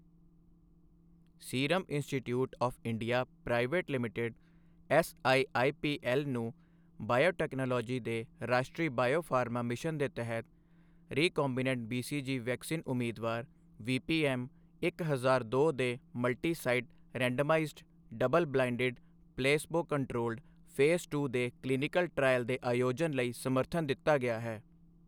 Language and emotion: Punjabi, neutral